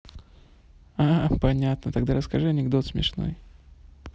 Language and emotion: Russian, neutral